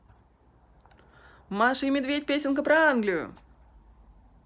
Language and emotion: Russian, positive